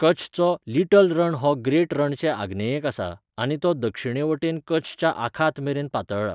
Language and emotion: Goan Konkani, neutral